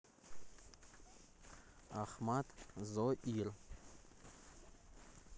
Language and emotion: Russian, neutral